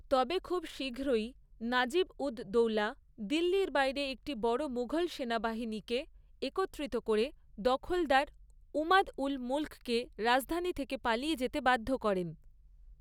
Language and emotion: Bengali, neutral